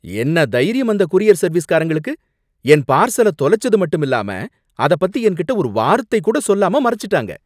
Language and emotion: Tamil, angry